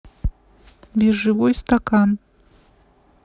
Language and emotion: Russian, neutral